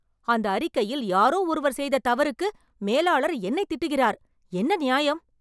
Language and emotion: Tamil, angry